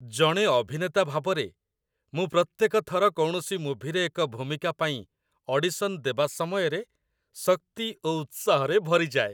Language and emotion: Odia, happy